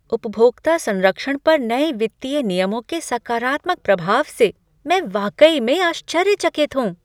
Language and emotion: Hindi, surprised